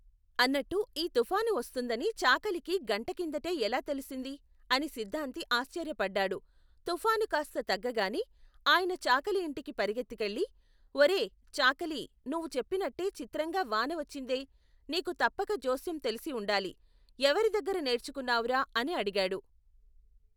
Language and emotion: Telugu, neutral